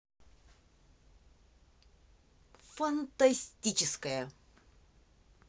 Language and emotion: Russian, positive